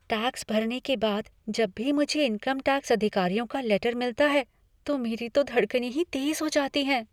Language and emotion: Hindi, fearful